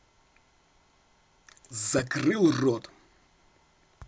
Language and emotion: Russian, angry